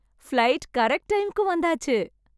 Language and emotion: Tamil, happy